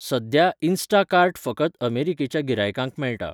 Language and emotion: Goan Konkani, neutral